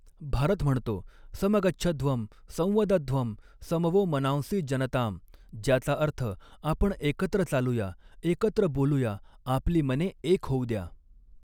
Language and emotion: Marathi, neutral